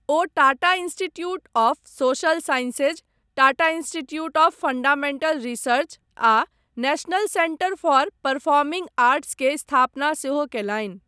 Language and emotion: Maithili, neutral